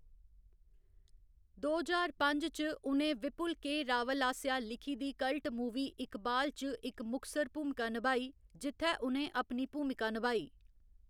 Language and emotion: Dogri, neutral